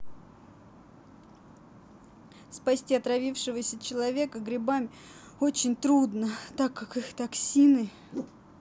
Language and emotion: Russian, sad